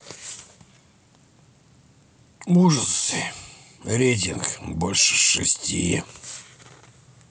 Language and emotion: Russian, neutral